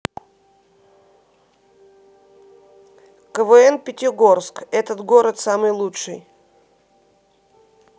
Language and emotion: Russian, neutral